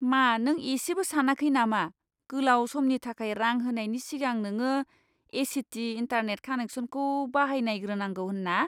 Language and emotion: Bodo, disgusted